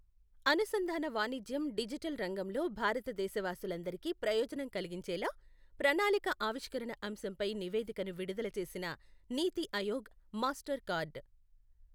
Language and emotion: Telugu, neutral